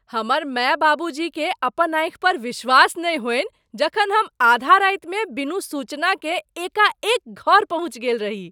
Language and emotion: Maithili, surprised